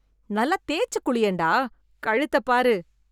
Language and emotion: Tamil, disgusted